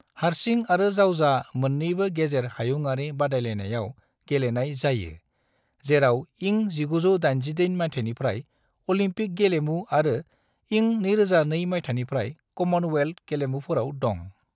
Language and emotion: Bodo, neutral